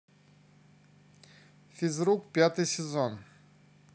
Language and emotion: Russian, neutral